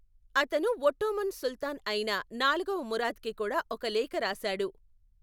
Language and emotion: Telugu, neutral